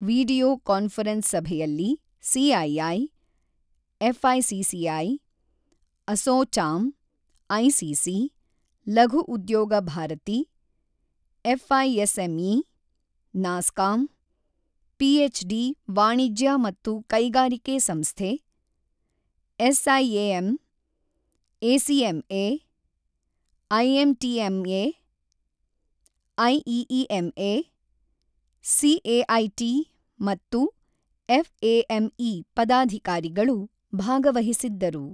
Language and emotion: Kannada, neutral